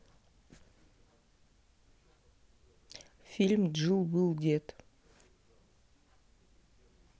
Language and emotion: Russian, neutral